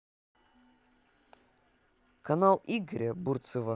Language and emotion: Russian, neutral